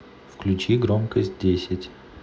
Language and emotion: Russian, neutral